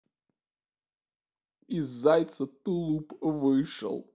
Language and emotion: Russian, sad